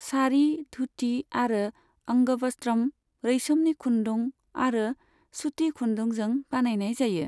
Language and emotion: Bodo, neutral